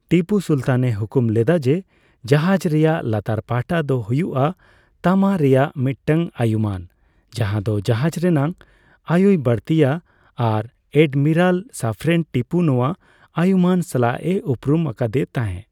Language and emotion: Santali, neutral